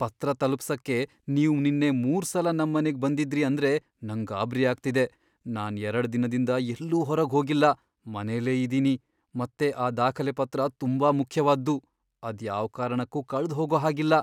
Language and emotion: Kannada, fearful